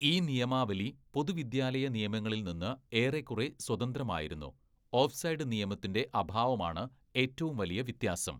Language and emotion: Malayalam, neutral